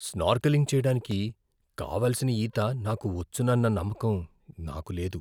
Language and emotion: Telugu, fearful